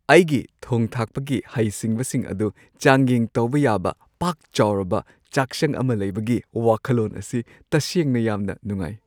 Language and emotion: Manipuri, happy